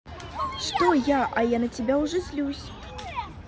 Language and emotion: Russian, positive